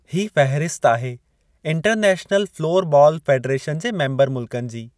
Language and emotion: Sindhi, neutral